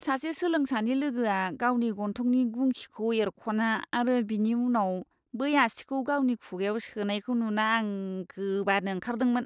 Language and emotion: Bodo, disgusted